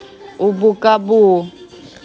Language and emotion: Russian, neutral